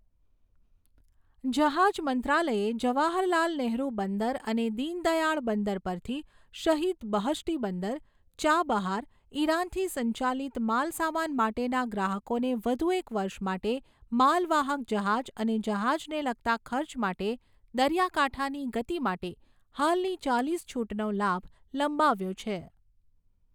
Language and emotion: Gujarati, neutral